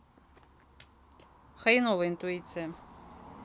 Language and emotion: Russian, neutral